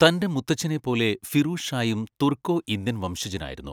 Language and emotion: Malayalam, neutral